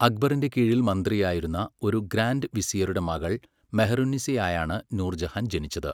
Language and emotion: Malayalam, neutral